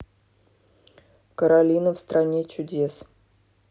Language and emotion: Russian, neutral